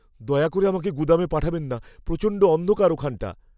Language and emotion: Bengali, fearful